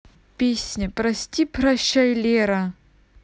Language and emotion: Russian, neutral